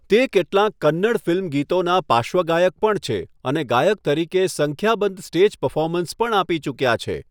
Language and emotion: Gujarati, neutral